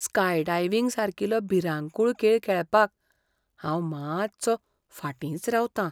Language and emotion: Goan Konkani, fearful